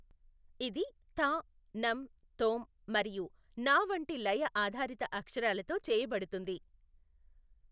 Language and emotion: Telugu, neutral